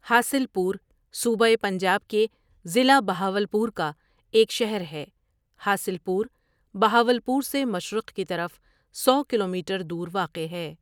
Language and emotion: Urdu, neutral